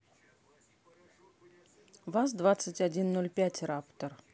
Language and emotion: Russian, neutral